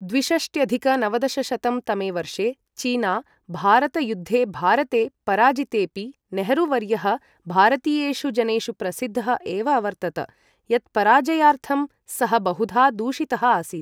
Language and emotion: Sanskrit, neutral